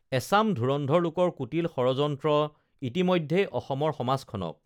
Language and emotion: Assamese, neutral